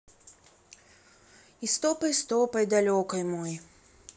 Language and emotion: Russian, sad